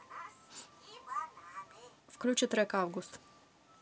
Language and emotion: Russian, neutral